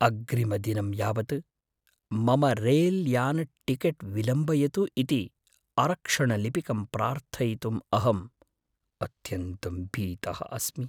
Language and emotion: Sanskrit, fearful